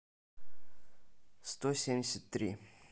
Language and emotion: Russian, neutral